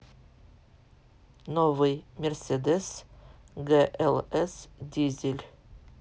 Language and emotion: Russian, neutral